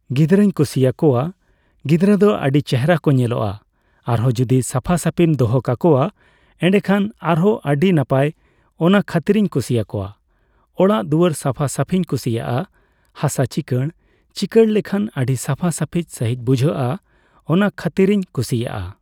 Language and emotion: Santali, neutral